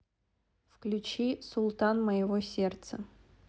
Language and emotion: Russian, neutral